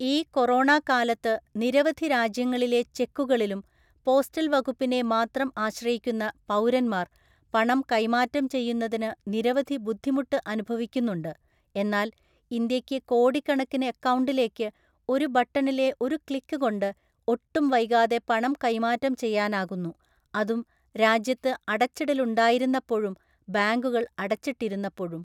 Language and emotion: Malayalam, neutral